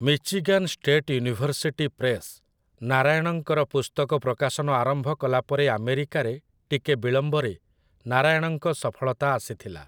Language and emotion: Odia, neutral